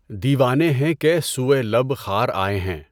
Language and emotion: Urdu, neutral